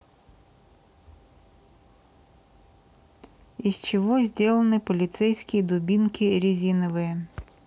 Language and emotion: Russian, neutral